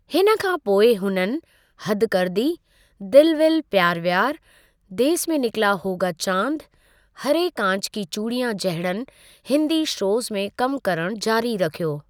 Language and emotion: Sindhi, neutral